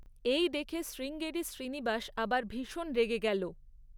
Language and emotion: Bengali, neutral